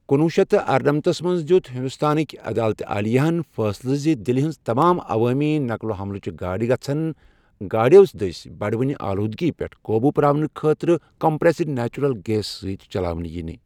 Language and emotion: Kashmiri, neutral